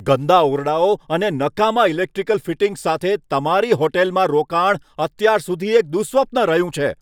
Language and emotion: Gujarati, angry